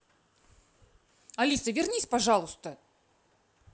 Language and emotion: Russian, angry